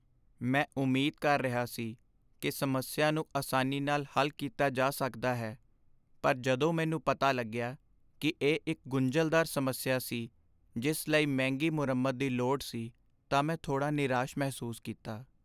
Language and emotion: Punjabi, sad